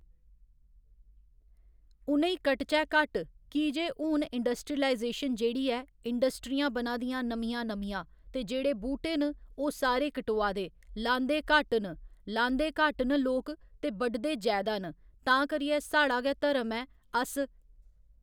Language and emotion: Dogri, neutral